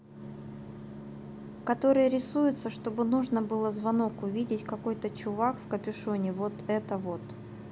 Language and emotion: Russian, neutral